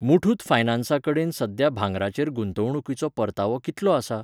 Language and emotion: Goan Konkani, neutral